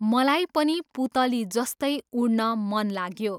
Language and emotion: Nepali, neutral